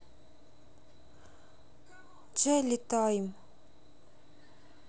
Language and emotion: Russian, sad